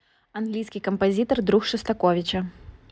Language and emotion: Russian, neutral